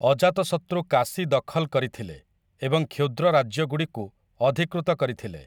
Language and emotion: Odia, neutral